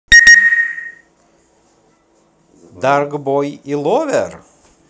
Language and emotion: Russian, positive